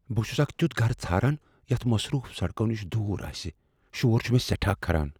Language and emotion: Kashmiri, fearful